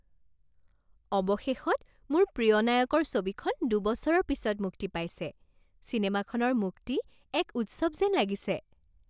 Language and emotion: Assamese, happy